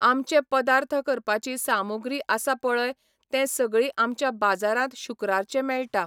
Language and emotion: Goan Konkani, neutral